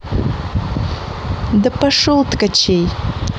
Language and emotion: Russian, angry